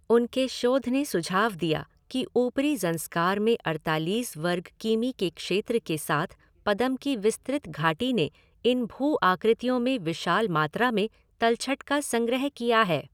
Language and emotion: Hindi, neutral